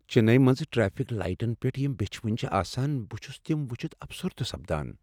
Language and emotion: Kashmiri, sad